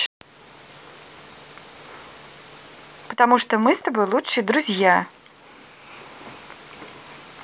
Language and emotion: Russian, positive